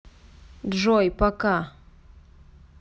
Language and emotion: Russian, neutral